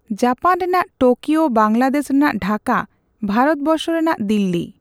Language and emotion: Santali, neutral